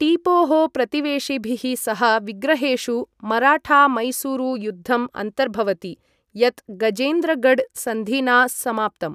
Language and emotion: Sanskrit, neutral